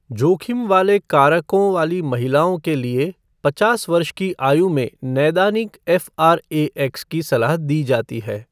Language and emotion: Hindi, neutral